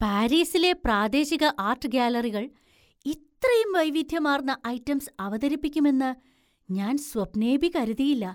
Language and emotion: Malayalam, surprised